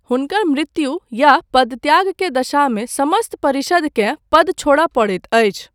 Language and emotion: Maithili, neutral